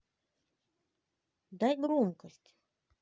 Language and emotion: Russian, neutral